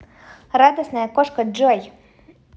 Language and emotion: Russian, positive